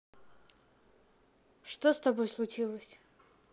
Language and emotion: Russian, neutral